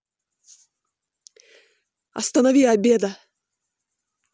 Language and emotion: Russian, angry